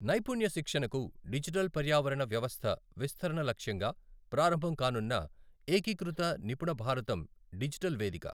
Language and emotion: Telugu, neutral